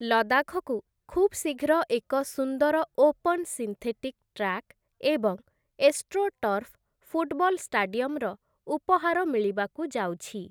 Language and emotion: Odia, neutral